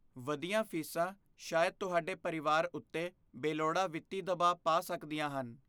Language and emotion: Punjabi, fearful